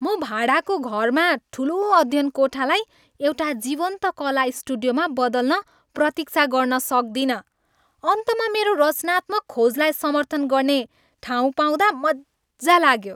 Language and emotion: Nepali, happy